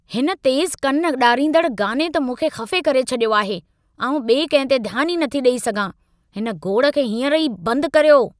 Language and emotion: Sindhi, angry